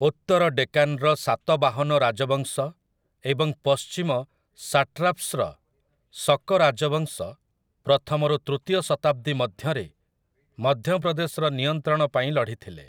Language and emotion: Odia, neutral